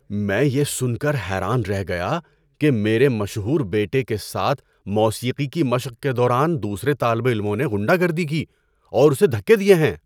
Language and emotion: Urdu, surprised